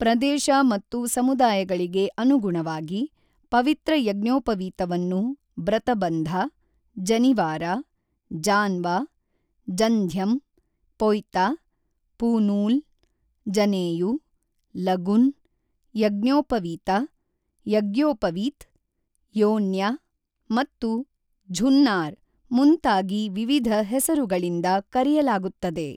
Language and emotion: Kannada, neutral